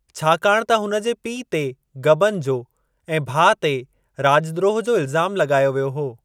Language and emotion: Sindhi, neutral